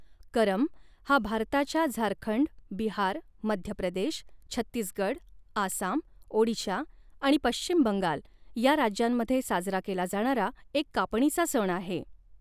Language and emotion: Marathi, neutral